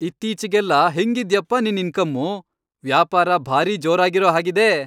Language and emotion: Kannada, happy